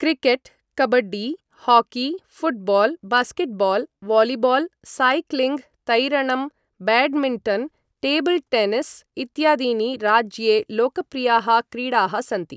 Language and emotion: Sanskrit, neutral